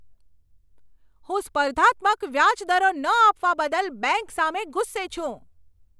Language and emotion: Gujarati, angry